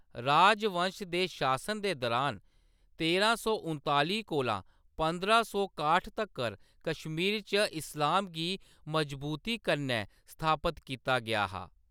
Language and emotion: Dogri, neutral